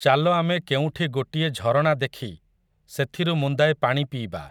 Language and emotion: Odia, neutral